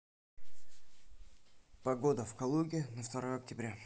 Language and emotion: Russian, neutral